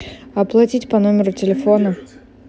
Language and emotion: Russian, neutral